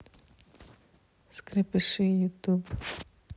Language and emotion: Russian, neutral